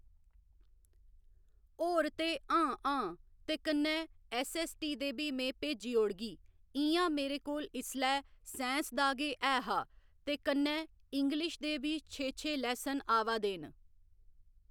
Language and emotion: Dogri, neutral